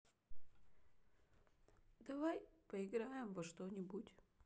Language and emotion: Russian, sad